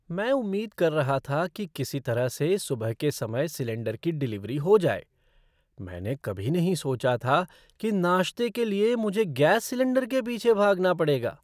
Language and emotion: Hindi, surprised